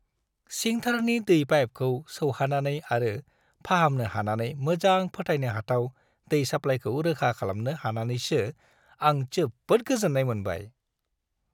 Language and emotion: Bodo, happy